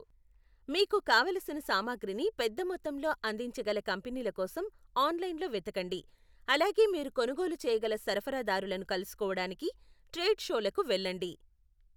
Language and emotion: Telugu, neutral